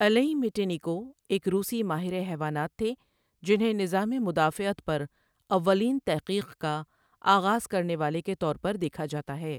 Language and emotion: Urdu, neutral